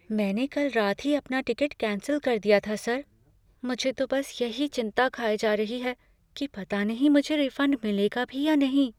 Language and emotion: Hindi, fearful